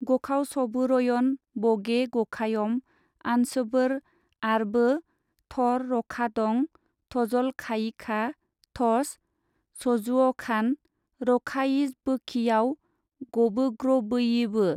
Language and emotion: Bodo, neutral